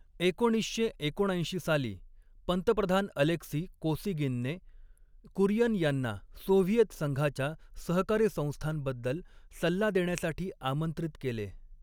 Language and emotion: Marathi, neutral